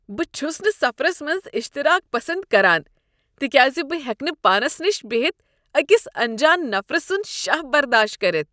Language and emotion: Kashmiri, disgusted